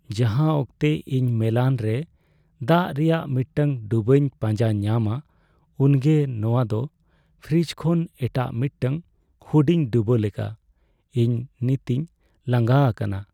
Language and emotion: Santali, sad